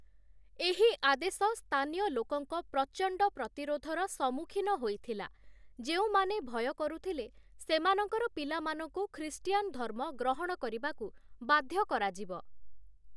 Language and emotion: Odia, neutral